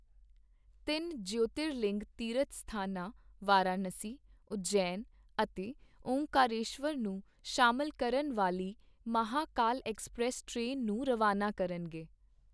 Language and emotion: Punjabi, neutral